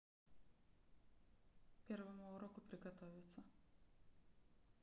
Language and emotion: Russian, neutral